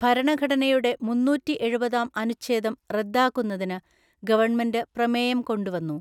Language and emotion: Malayalam, neutral